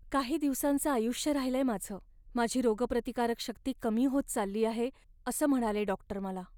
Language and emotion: Marathi, sad